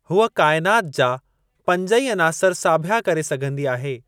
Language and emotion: Sindhi, neutral